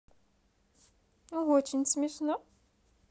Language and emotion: Russian, positive